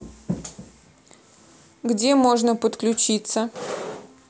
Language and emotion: Russian, neutral